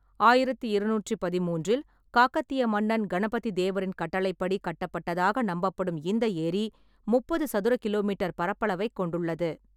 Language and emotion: Tamil, neutral